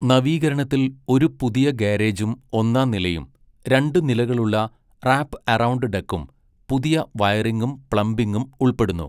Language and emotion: Malayalam, neutral